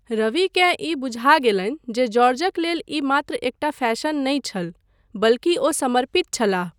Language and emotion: Maithili, neutral